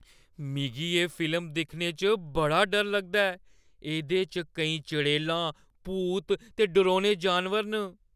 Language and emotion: Dogri, fearful